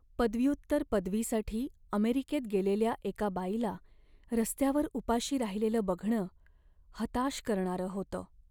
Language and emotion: Marathi, sad